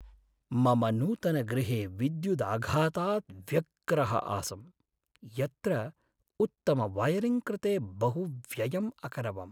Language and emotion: Sanskrit, sad